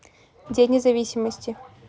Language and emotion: Russian, neutral